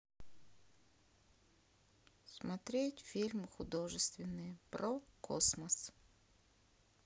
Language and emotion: Russian, sad